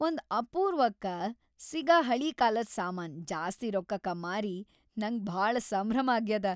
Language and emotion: Kannada, happy